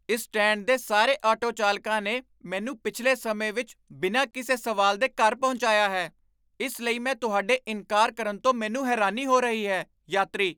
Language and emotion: Punjabi, surprised